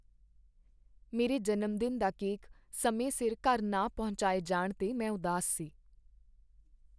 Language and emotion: Punjabi, sad